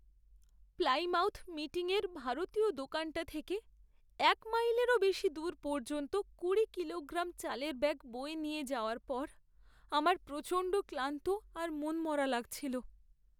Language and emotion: Bengali, sad